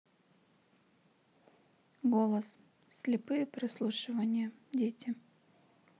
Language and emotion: Russian, neutral